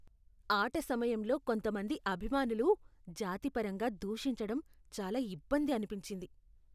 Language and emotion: Telugu, disgusted